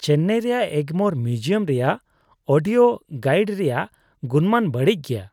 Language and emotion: Santali, disgusted